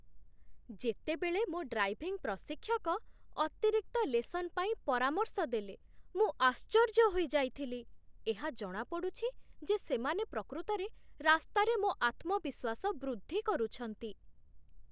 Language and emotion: Odia, surprised